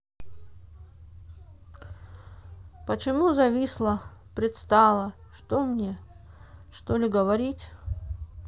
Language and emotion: Russian, sad